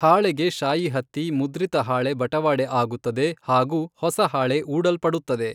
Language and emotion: Kannada, neutral